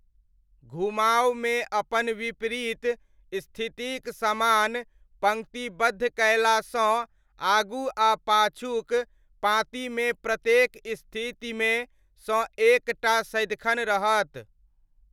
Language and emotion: Maithili, neutral